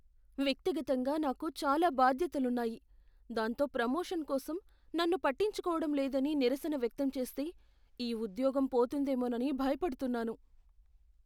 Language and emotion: Telugu, fearful